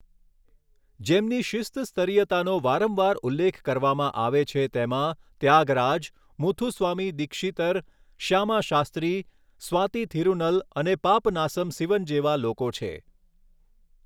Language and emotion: Gujarati, neutral